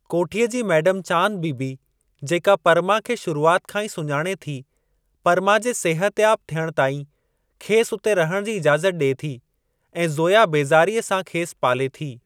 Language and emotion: Sindhi, neutral